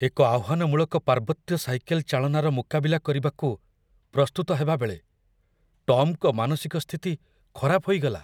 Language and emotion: Odia, fearful